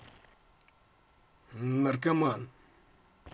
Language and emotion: Russian, angry